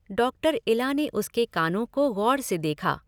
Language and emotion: Hindi, neutral